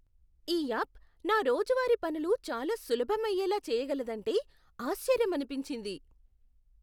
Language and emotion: Telugu, surprised